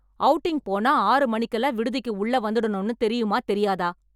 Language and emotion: Tamil, angry